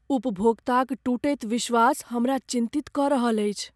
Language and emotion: Maithili, fearful